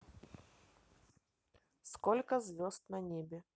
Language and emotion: Russian, neutral